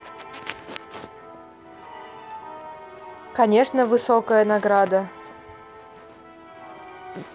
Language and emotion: Russian, neutral